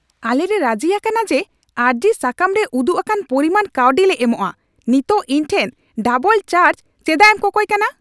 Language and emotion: Santali, angry